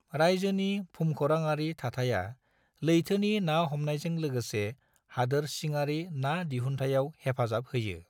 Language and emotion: Bodo, neutral